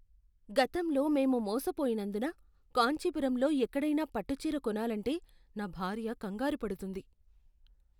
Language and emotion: Telugu, fearful